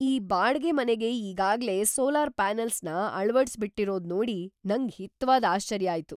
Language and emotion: Kannada, surprised